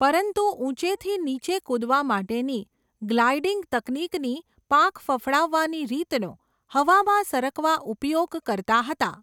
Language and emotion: Gujarati, neutral